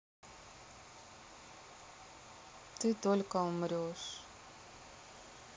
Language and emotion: Russian, sad